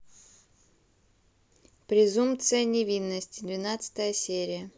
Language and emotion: Russian, neutral